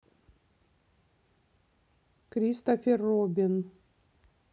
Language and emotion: Russian, neutral